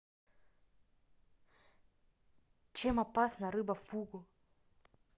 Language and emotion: Russian, neutral